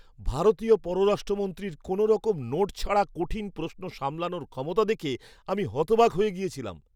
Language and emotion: Bengali, surprised